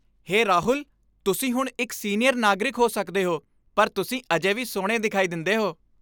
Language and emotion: Punjabi, happy